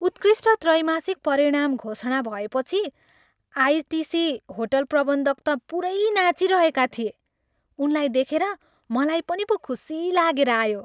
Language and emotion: Nepali, happy